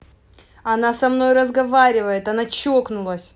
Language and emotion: Russian, angry